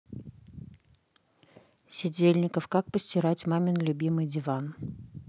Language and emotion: Russian, neutral